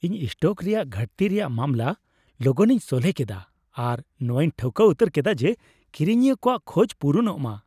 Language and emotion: Santali, happy